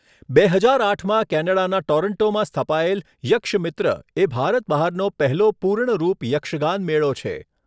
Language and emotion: Gujarati, neutral